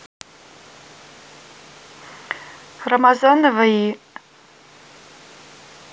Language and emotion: Russian, neutral